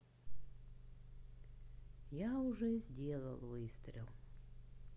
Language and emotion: Russian, sad